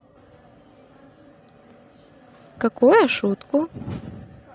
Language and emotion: Russian, positive